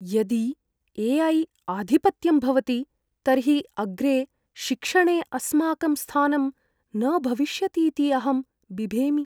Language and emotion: Sanskrit, fearful